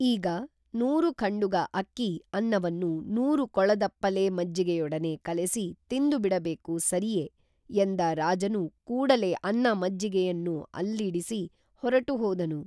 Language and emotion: Kannada, neutral